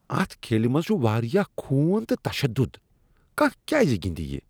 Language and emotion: Kashmiri, disgusted